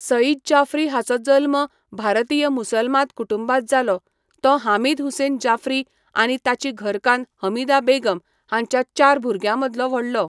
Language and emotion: Goan Konkani, neutral